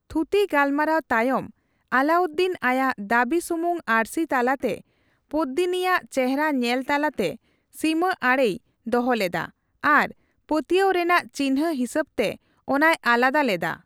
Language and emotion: Santali, neutral